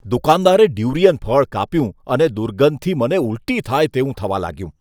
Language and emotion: Gujarati, disgusted